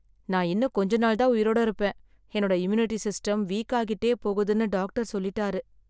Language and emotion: Tamil, sad